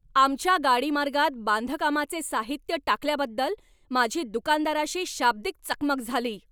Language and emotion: Marathi, angry